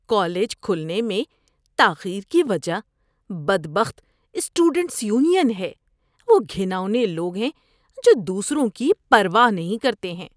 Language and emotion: Urdu, disgusted